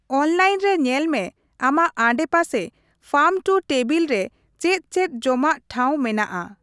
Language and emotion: Santali, neutral